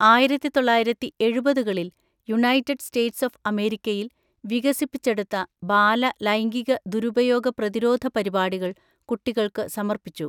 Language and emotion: Malayalam, neutral